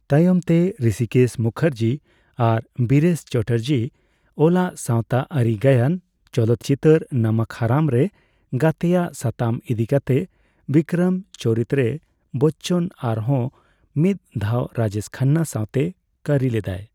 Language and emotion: Santali, neutral